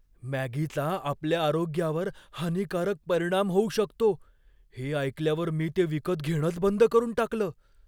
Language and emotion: Marathi, fearful